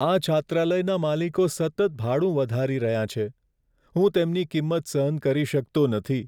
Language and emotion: Gujarati, sad